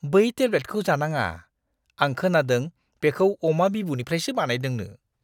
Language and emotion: Bodo, disgusted